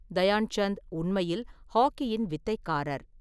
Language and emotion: Tamil, neutral